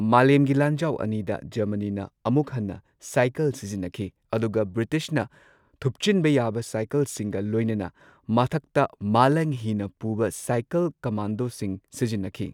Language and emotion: Manipuri, neutral